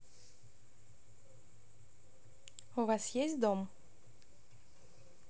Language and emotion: Russian, neutral